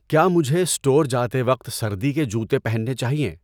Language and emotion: Urdu, neutral